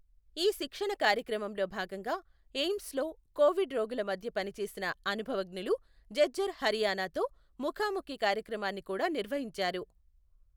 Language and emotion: Telugu, neutral